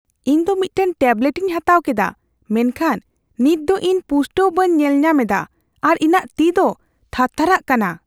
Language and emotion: Santali, fearful